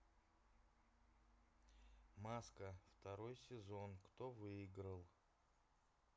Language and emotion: Russian, neutral